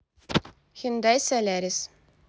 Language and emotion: Russian, neutral